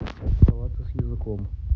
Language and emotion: Russian, neutral